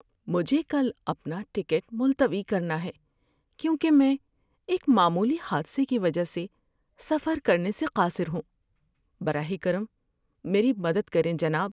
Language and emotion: Urdu, sad